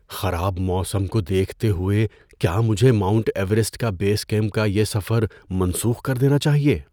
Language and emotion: Urdu, fearful